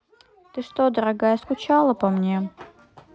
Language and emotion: Russian, neutral